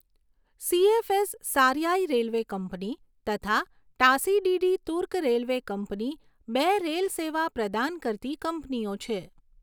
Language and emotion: Gujarati, neutral